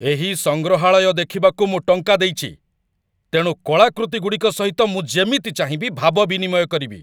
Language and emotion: Odia, angry